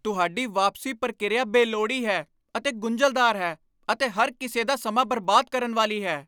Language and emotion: Punjabi, angry